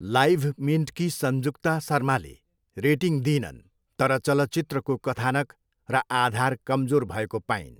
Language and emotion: Nepali, neutral